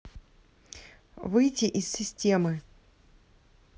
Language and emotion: Russian, neutral